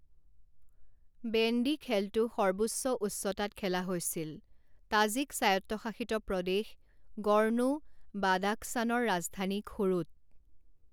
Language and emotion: Assamese, neutral